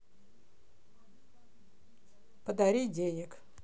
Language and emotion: Russian, neutral